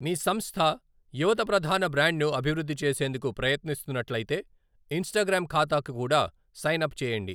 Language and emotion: Telugu, neutral